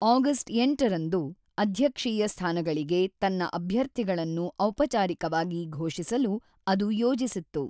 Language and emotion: Kannada, neutral